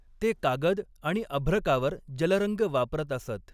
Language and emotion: Marathi, neutral